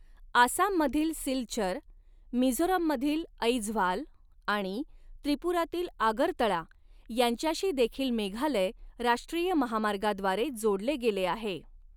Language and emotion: Marathi, neutral